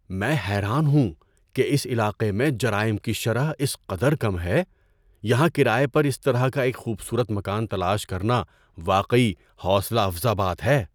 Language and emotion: Urdu, surprised